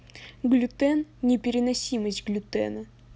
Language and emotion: Russian, neutral